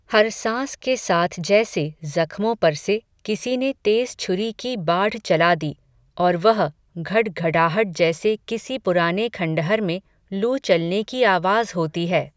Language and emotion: Hindi, neutral